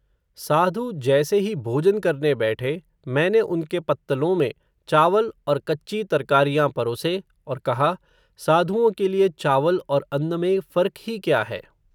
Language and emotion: Hindi, neutral